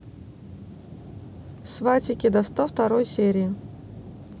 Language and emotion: Russian, neutral